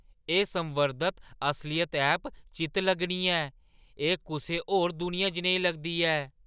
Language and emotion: Dogri, surprised